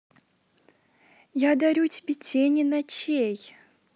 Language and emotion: Russian, neutral